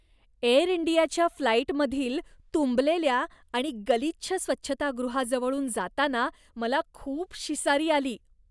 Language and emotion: Marathi, disgusted